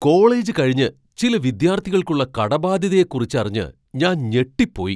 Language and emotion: Malayalam, surprised